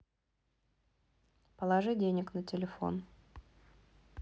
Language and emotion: Russian, neutral